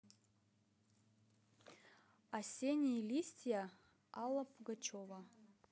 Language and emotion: Russian, neutral